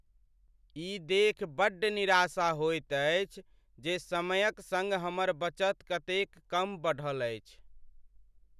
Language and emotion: Maithili, sad